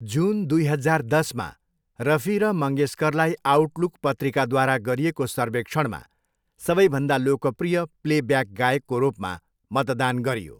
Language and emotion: Nepali, neutral